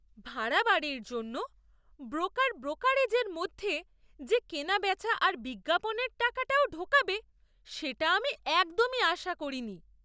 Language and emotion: Bengali, surprised